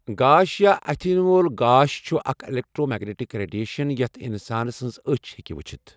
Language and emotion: Kashmiri, neutral